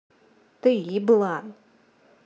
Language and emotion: Russian, angry